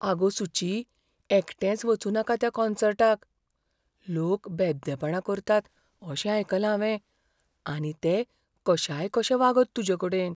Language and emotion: Goan Konkani, fearful